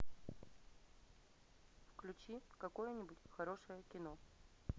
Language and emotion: Russian, neutral